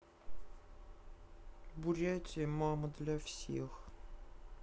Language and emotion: Russian, sad